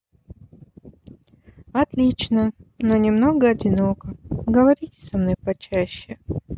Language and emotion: Russian, neutral